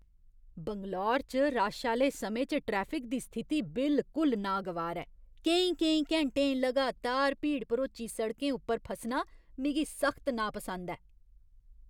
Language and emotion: Dogri, disgusted